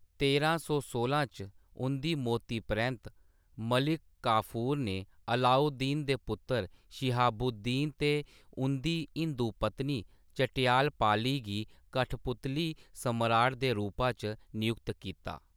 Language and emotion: Dogri, neutral